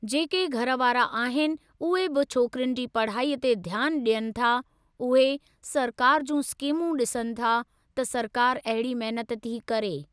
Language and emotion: Sindhi, neutral